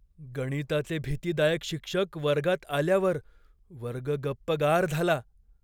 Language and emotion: Marathi, fearful